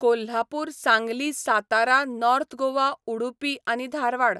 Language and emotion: Goan Konkani, neutral